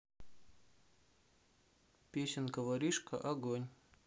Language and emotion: Russian, neutral